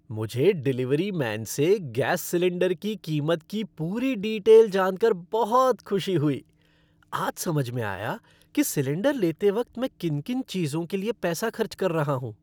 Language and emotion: Hindi, happy